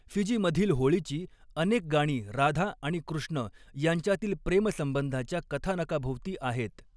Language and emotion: Marathi, neutral